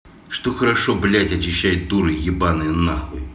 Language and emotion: Russian, angry